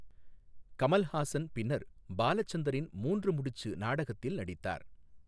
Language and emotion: Tamil, neutral